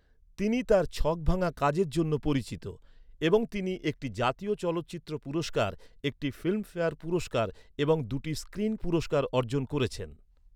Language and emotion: Bengali, neutral